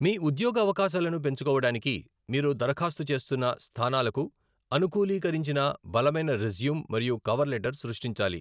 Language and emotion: Telugu, neutral